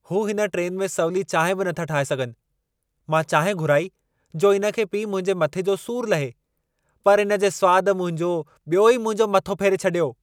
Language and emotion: Sindhi, angry